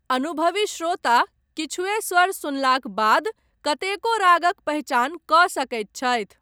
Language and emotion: Maithili, neutral